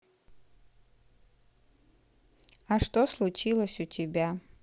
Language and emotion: Russian, neutral